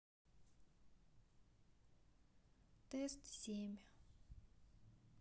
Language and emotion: Russian, neutral